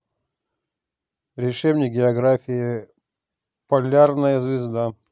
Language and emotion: Russian, neutral